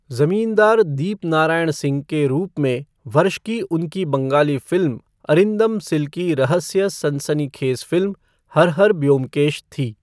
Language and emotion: Hindi, neutral